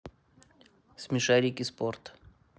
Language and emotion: Russian, neutral